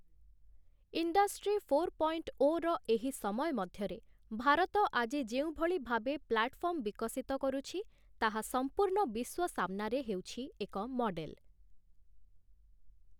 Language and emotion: Odia, neutral